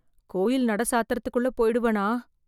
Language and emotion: Tamil, fearful